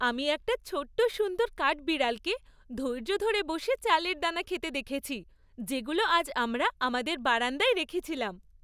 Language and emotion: Bengali, happy